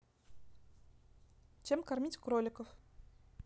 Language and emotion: Russian, neutral